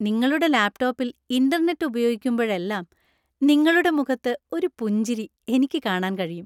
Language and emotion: Malayalam, happy